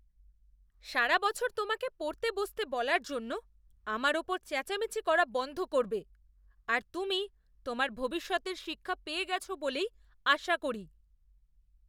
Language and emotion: Bengali, disgusted